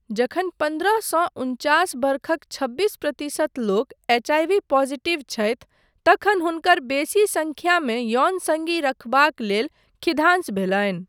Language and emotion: Maithili, neutral